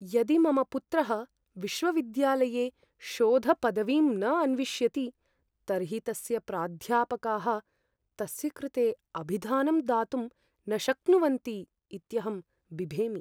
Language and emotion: Sanskrit, fearful